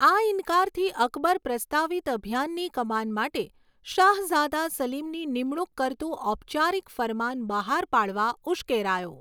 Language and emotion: Gujarati, neutral